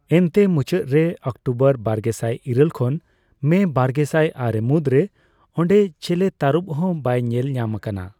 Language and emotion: Santali, neutral